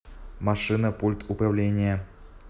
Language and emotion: Russian, neutral